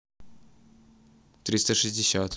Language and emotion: Russian, neutral